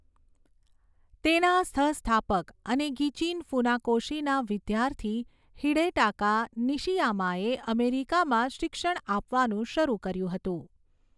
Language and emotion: Gujarati, neutral